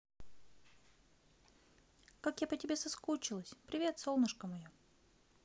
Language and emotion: Russian, positive